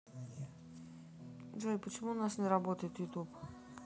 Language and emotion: Russian, neutral